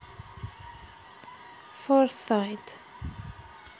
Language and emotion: Russian, neutral